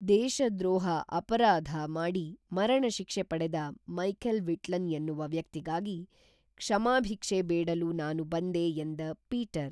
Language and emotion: Kannada, neutral